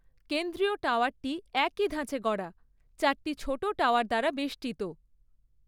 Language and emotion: Bengali, neutral